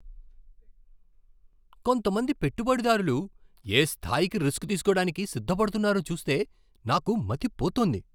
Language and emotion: Telugu, surprised